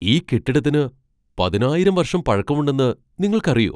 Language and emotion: Malayalam, surprised